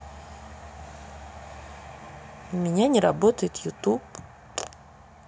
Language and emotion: Russian, sad